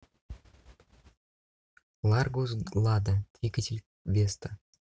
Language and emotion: Russian, neutral